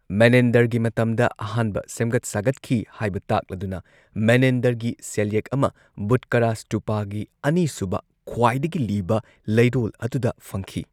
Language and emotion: Manipuri, neutral